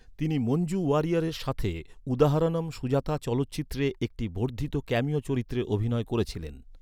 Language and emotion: Bengali, neutral